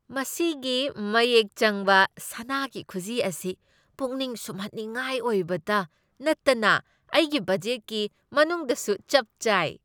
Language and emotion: Manipuri, happy